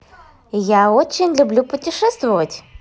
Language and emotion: Russian, positive